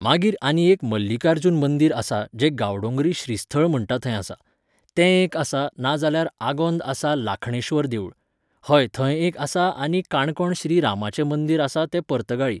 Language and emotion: Goan Konkani, neutral